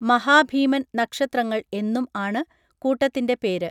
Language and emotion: Malayalam, neutral